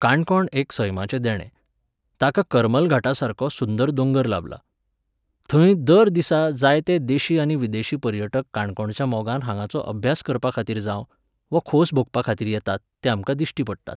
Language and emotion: Goan Konkani, neutral